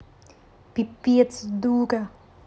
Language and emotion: Russian, angry